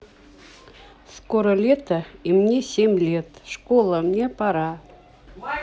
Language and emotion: Russian, neutral